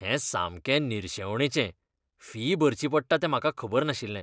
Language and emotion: Goan Konkani, disgusted